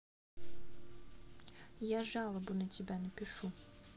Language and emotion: Russian, neutral